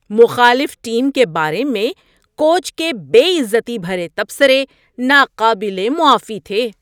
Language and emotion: Urdu, disgusted